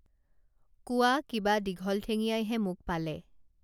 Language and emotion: Assamese, neutral